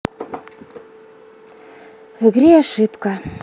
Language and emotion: Russian, sad